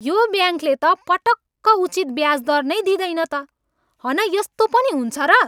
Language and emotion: Nepali, angry